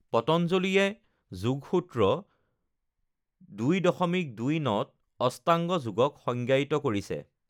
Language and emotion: Assamese, neutral